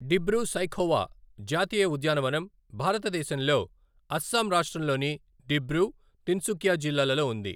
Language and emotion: Telugu, neutral